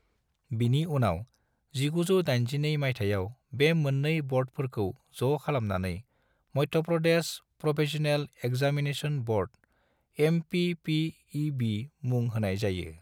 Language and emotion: Bodo, neutral